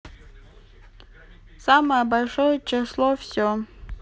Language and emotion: Russian, neutral